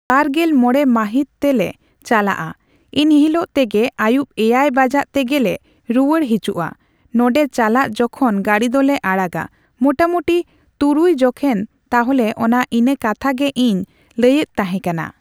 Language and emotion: Santali, neutral